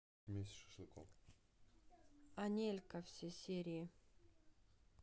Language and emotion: Russian, neutral